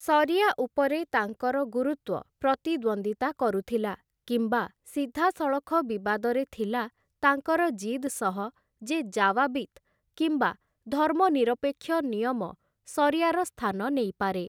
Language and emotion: Odia, neutral